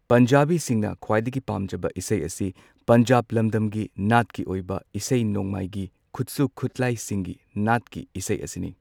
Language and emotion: Manipuri, neutral